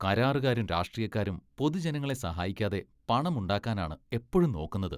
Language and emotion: Malayalam, disgusted